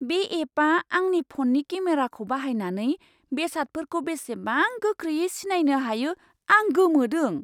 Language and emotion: Bodo, surprised